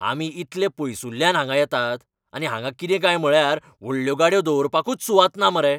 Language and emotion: Goan Konkani, angry